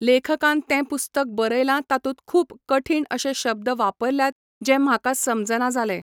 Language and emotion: Goan Konkani, neutral